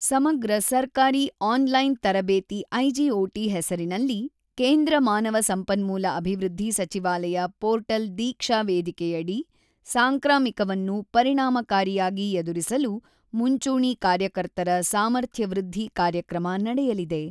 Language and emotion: Kannada, neutral